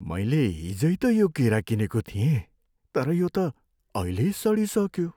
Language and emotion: Nepali, sad